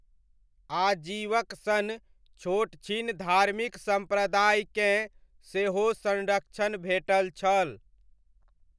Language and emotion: Maithili, neutral